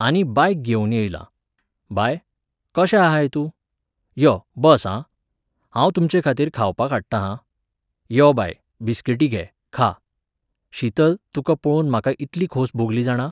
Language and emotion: Goan Konkani, neutral